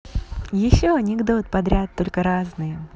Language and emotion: Russian, positive